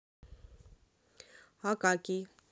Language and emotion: Russian, neutral